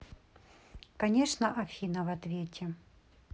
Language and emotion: Russian, neutral